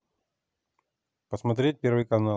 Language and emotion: Russian, neutral